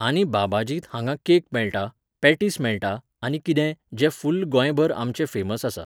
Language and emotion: Goan Konkani, neutral